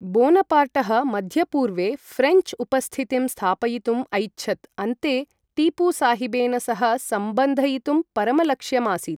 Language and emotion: Sanskrit, neutral